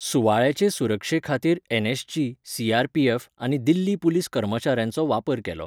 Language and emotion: Goan Konkani, neutral